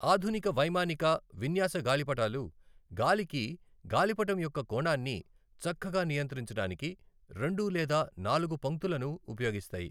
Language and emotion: Telugu, neutral